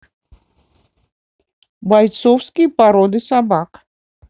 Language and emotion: Russian, neutral